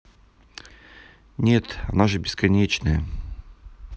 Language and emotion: Russian, neutral